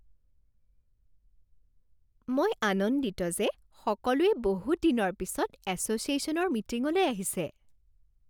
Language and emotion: Assamese, happy